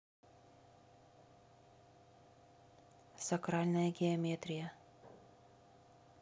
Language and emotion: Russian, neutral